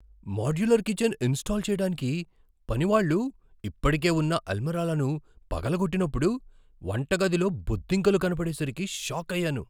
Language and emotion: Telugu, surprised